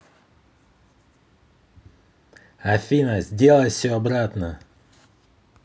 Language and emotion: Russian, angry